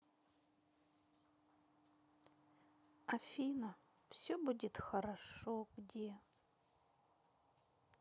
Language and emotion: Russian, sad